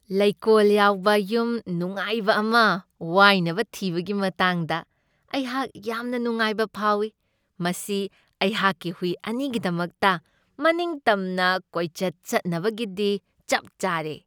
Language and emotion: Manipuri, happy